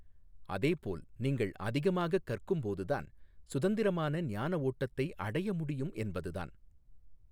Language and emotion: Tamil, neutral